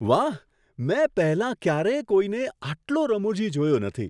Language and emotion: Gujarati, surprised